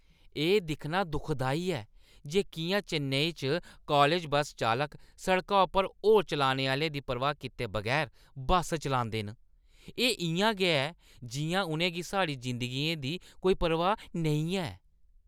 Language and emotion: Dogri, disgusted